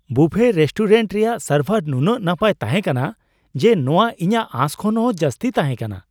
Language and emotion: Santali, surprised